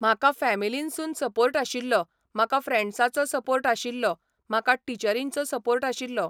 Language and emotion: Goan Konkani, neutral